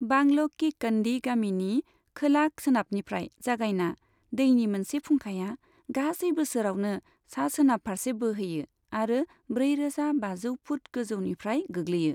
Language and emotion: Bodo, neutral